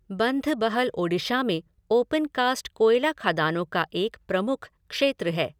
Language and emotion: Hindi, neutral